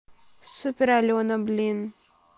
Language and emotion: Russian, neutral